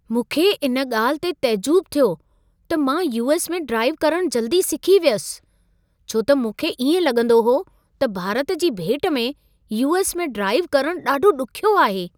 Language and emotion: Sindhi, surprised